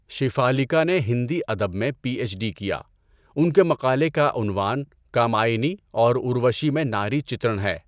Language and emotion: Urdu, neutral